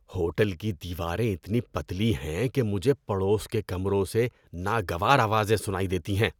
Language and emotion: Urdu, disgusted